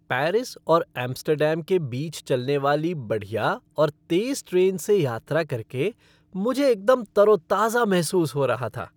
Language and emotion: Hindi, happy